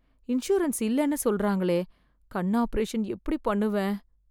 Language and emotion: Tamil, fearful